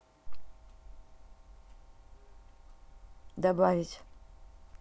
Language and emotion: Russian, neutral